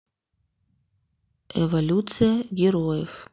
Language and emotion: Russian, neutral